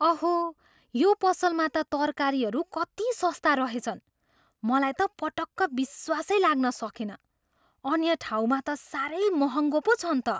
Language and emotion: Nepali, surprised